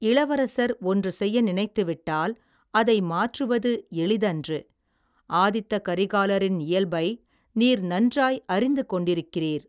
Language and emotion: Tamil, neutral